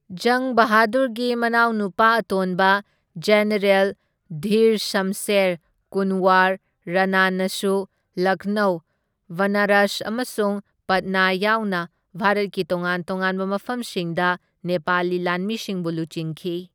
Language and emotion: Manipuri, neutral